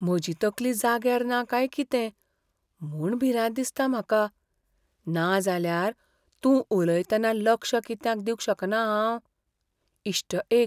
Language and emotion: Goan Konkani, fearful